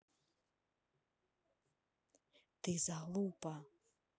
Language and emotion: Russian, neutral